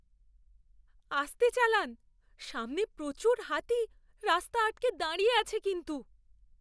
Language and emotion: Bengali, fearful